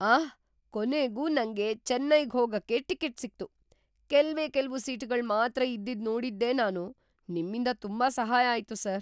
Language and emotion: Kannada, surprised